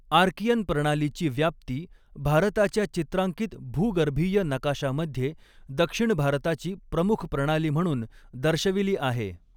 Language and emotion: Marathi, neutral